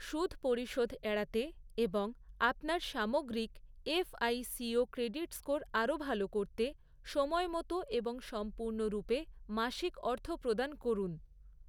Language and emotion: Bengali, neutral